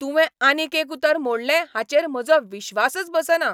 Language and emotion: Goan Konkani, angry